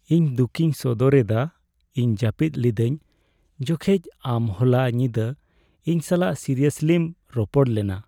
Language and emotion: Santali, sad